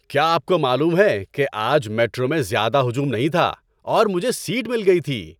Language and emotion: Urdu, happy